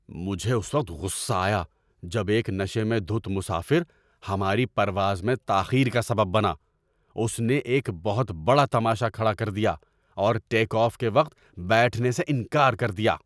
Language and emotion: Urdu, angry